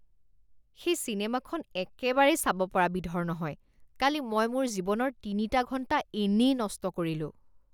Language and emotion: Assamese, disgusted